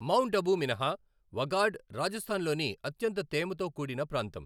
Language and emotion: Telugu, neutral